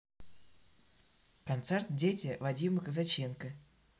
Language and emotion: Russian, neutral